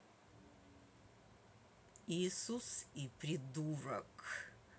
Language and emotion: Russian, angry